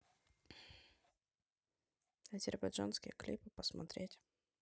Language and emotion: Russian, neutral